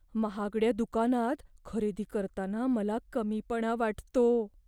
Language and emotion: Marathi, fearful